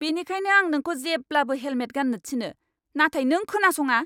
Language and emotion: Bodo, angry